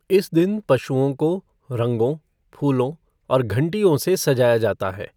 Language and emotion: Hindi, neutral